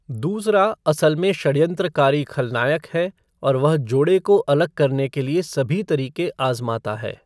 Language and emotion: Hindi, neutral